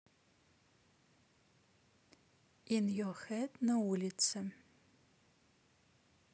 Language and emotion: Russian, neutral